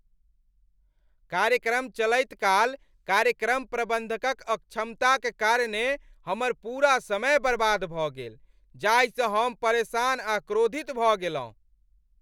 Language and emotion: Maithili, angry